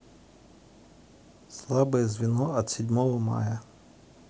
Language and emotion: Russian, neutral